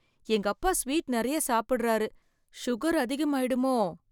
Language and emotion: Tamil, fearful